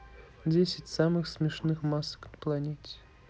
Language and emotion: Russian, neutral